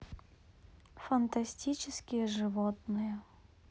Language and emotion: Russian, neutral